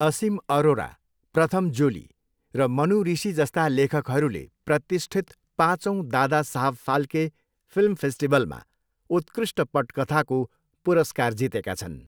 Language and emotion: Nepali, neutral